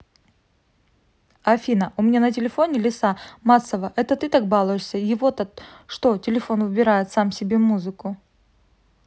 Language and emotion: Russian, neutral